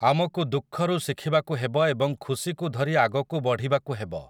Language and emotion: Odia, neutral